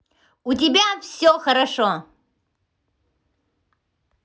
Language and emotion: Russian, positive